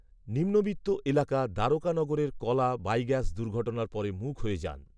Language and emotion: Bengali, neutral